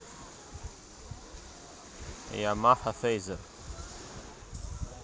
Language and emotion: Russian, neutral